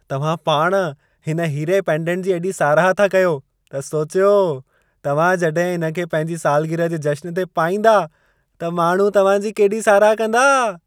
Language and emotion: Sindhi, happy